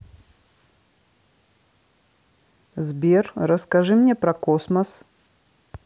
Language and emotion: Russian, neutral